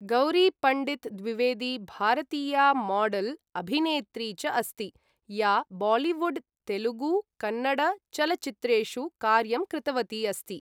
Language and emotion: Sanskrit, neutral